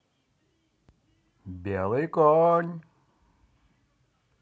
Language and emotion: Russian, positive